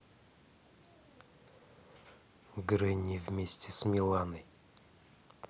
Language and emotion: Russian, neutral